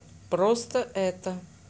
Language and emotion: Russian, neutral